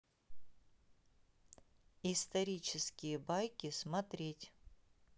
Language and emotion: Russian, neutral